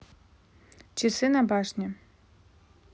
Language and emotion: Russian, neutral